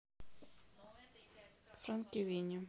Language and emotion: Russian, neutral